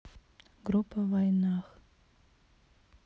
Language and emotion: Russian, sad